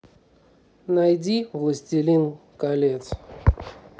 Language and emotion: Russian, neutral